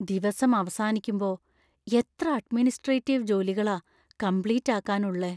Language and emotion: Malayalam, fearful